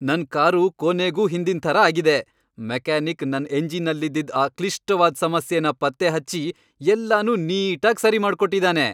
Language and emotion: Kannada, happy